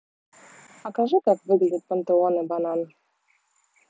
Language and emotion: Russian, neutral